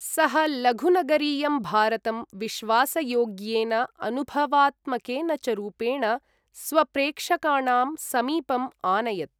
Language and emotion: Sanskrit, neutral